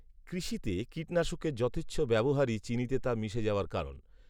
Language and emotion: Bengali, neutral